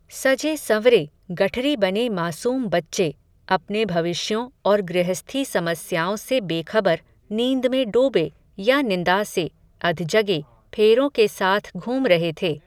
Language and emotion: Hindi, neutral